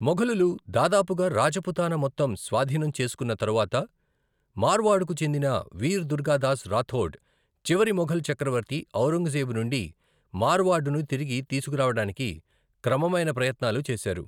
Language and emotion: Telugu, neutral